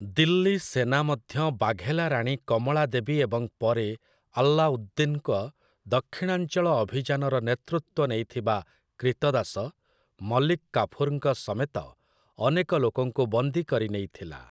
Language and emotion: Odia, neutral